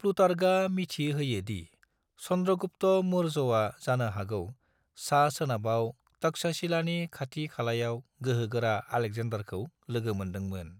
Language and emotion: Bodo, neutral